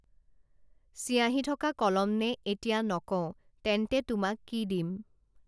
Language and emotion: Assamese, neutral